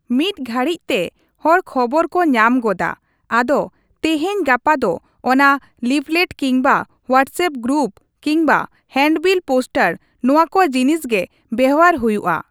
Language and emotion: Santali, neutral